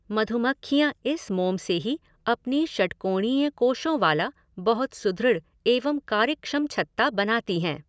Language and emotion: Hindi, neutral